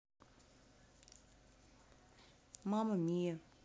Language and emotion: Russian, neutral